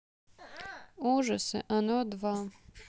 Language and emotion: Russian, neutral